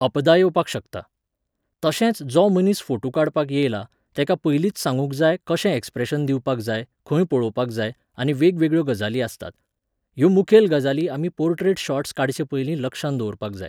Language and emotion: Goan Konkani, neutral